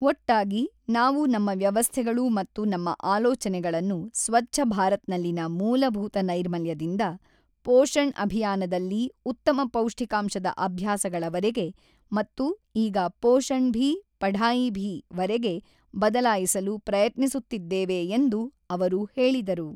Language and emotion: Kannada, neutral